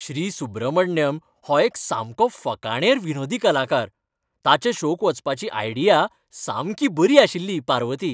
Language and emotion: Goan Konkani, happy